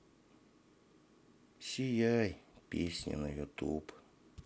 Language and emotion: Russian, sad